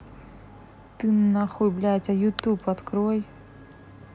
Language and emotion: Russian, angry